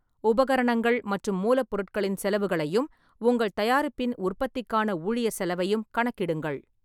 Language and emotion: Tamil, neutral